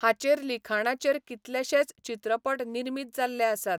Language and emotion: Goan Konkani, neutral